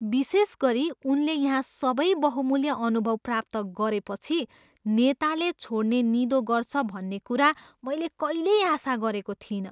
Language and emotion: Nepali, surprised